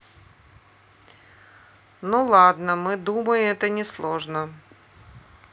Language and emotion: Russian, neutral